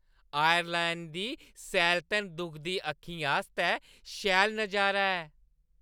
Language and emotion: Dogri, happy